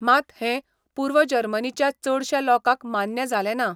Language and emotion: Goan Konkani, neutral